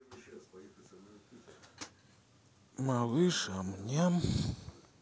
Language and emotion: Russian, sad